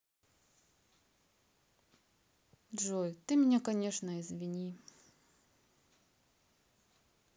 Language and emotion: Russian, sad